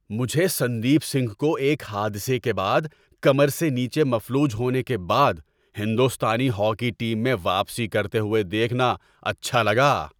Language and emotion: Urdu, happy